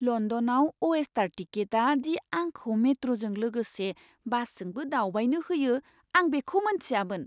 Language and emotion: Bodo, surprised